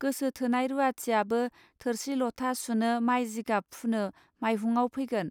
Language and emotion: Bodo, neutral